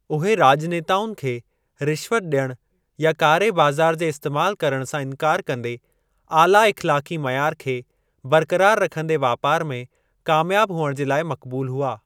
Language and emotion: Sindhi, neutral